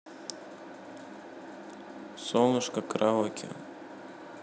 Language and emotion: Russian, neutral